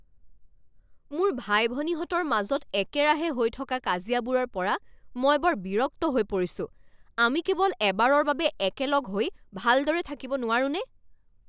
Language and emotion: Assamese, angry